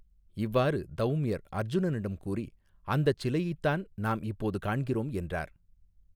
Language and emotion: Tamil, neutral